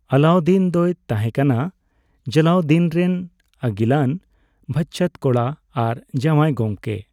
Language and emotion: Santali, neutral